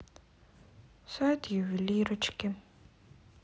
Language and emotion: Russian, sad